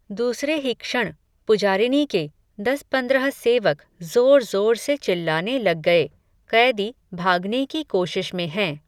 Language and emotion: Hindi, neutral